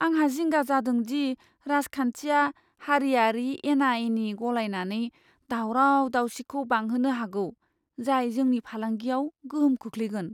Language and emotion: Bodo, fearful